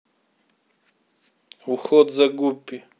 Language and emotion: Russian, neutral